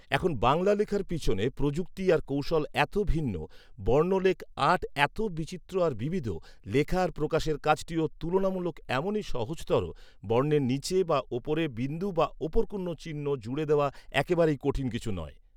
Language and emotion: Bengali, neutral